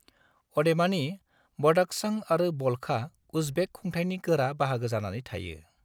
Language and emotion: Bodo, neutral